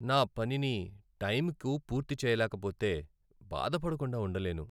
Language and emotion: Telugu, sad